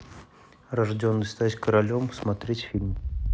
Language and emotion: Russian, neutral